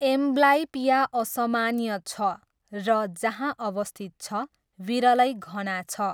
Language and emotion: Nepali, neutral